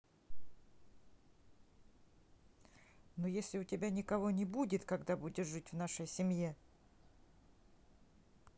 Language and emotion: Russian, neutral